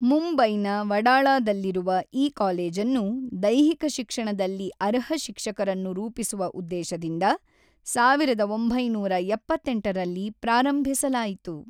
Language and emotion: Kannada, neutral